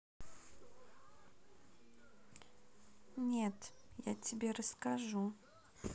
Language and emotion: Russian, neutral